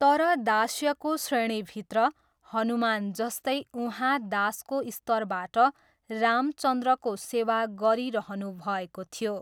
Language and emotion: Nepali, neutral